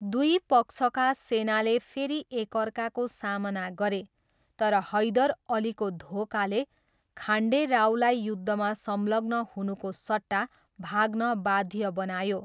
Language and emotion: Nepali, neutral